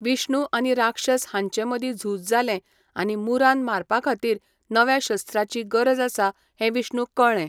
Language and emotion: Goan Konkani, neutral